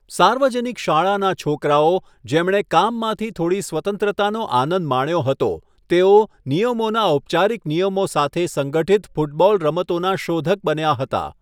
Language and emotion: Gujarati, neutral